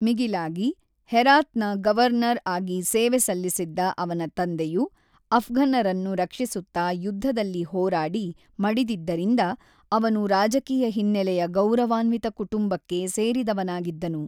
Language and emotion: Kannada, neutral